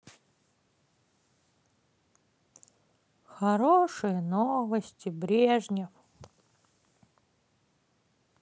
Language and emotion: Russian, sad